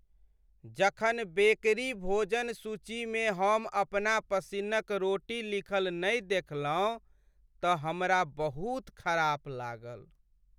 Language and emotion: Maithili, sad